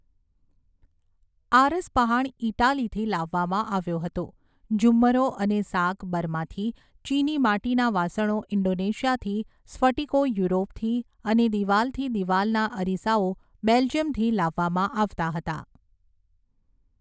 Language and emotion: Gujarati, neutral